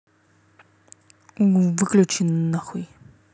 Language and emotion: Russian, angry